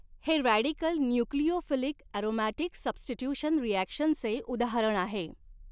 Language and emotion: Marathi, neutral